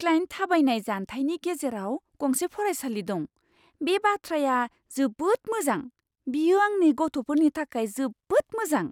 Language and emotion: Bodo, surprised